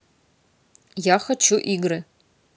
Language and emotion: Russian, neutral